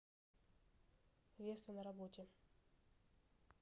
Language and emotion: Russian, neutral